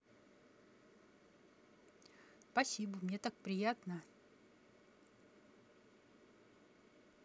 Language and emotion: Russian, positive